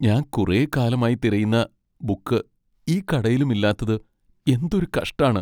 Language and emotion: Malayalam, sad